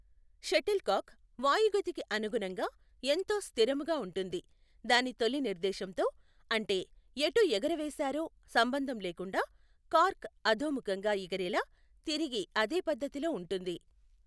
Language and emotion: Telugu, neutral